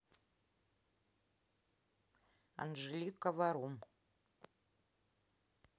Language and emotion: Russian, neutral